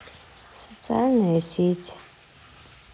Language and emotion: Russian, sad